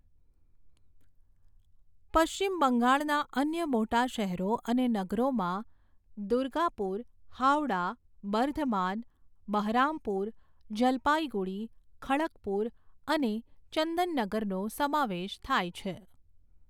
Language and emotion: Gujarati, neutral